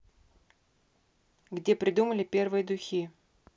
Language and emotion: Russian, neutral